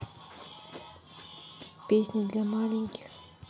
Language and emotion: Russian, neutral